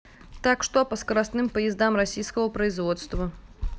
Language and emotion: Russian, neutral